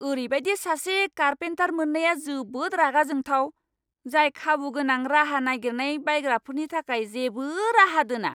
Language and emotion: Bodo, angry